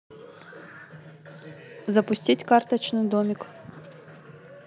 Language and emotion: Russian, neutral